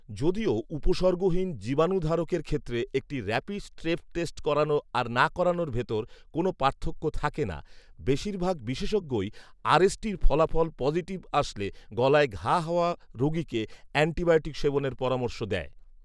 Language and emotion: Bengali, neutral